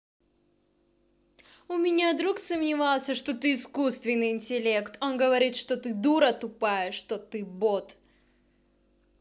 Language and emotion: Russian, angry